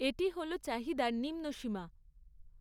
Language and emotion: Bengali, neutral